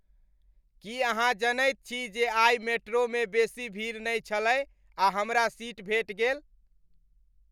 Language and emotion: Maithili, happy